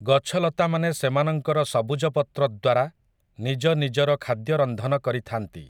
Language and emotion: Odia, neutral